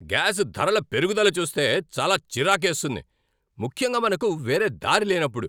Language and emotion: Telugu, angry